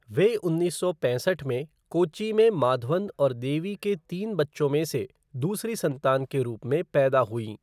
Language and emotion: Hindi, neutral